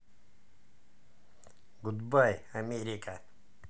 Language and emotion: Russian, positive